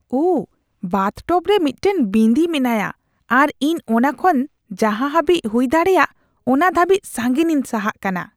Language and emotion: Santali, disgusted